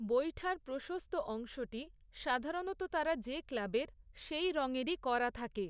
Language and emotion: Bengali, neutral